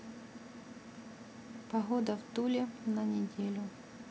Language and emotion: Russian, neutral